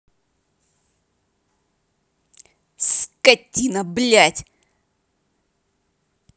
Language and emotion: Russian, angry